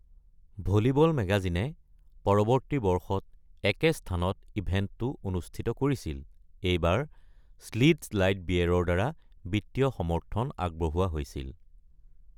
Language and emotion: Assamese, neutral